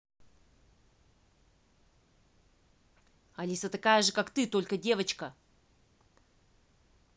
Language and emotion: Russian, angry